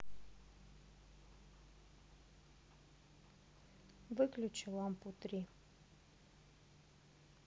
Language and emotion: Russian, neutral